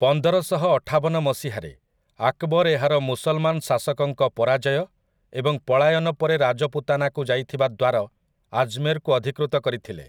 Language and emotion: Odia, neutral